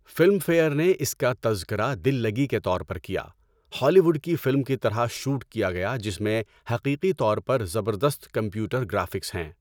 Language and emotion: Urdu, neutral